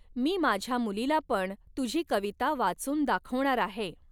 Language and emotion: Marathi, neutral